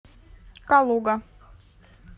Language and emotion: Russian, neutral